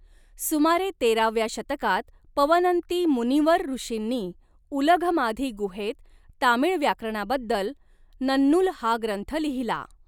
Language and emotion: Marathi, neutral